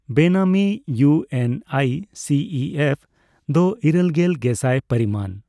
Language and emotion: Santali, neutral